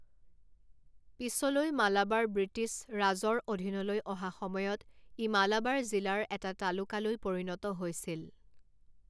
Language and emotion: Assamese, neutral